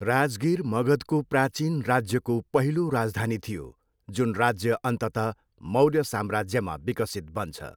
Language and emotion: Nepali, neutral